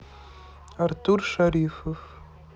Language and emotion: Russian, neutral